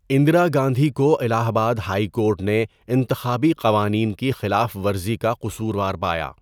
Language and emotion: Urdu, neutral